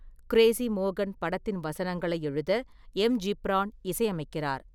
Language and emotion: Tamil, neutral